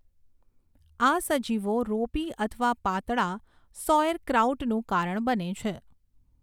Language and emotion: Gujarati, neutral